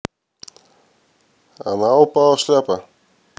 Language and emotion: Russian, neutral